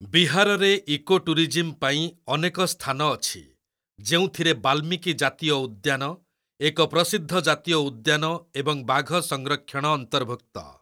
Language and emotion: Odia, neutral